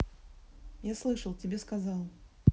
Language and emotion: Russian, neutral